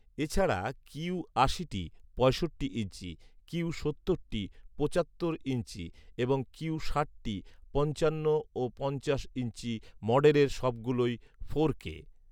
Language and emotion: Bengali, neutral